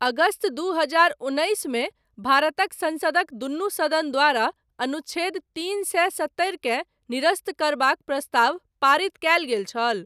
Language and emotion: Maithili, neutral